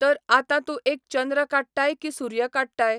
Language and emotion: Goan Konkani, neutral